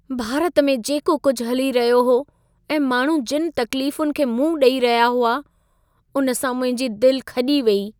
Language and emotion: Sindhi, sad